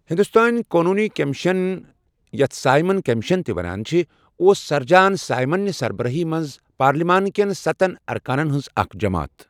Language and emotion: Kashmiri, neutral